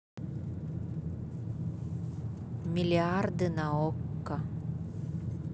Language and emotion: Russian, neutral